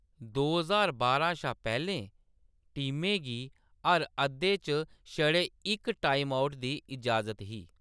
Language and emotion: Dogri, neutral